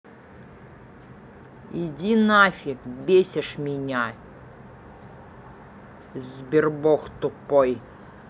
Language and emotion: Russian, angry